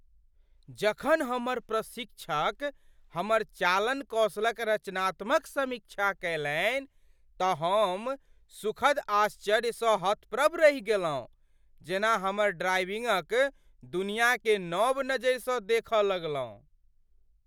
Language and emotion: Maithili, surprised